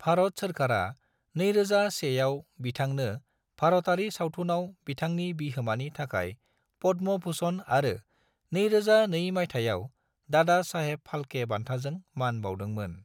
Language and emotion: Bodo, neutral